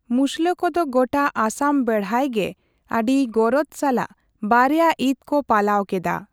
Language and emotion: Santali, neutral